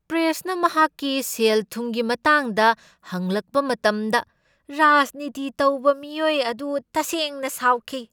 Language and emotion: Manipuri, angry